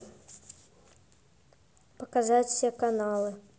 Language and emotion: Russian, neutral